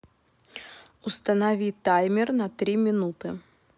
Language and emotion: Russian, neutral